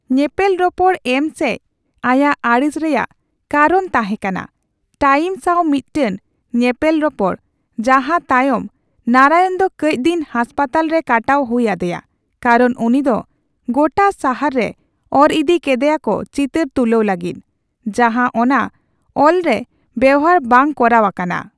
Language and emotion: Santali, neutral